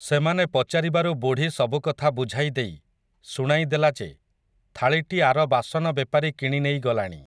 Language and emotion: Odia, neutral